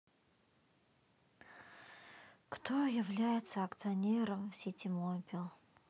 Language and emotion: Russian, sad